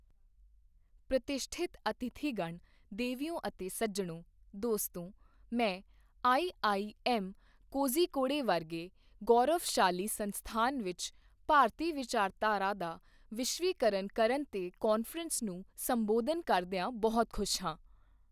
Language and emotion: Punjabi, neutral